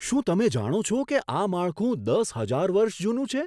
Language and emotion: Gujarati, surprised